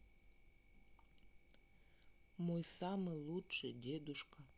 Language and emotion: Russian, neutral